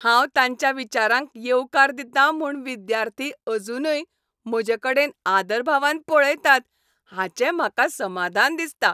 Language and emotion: Goan Konkani, happy